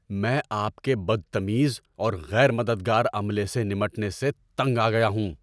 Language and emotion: Urdu, angry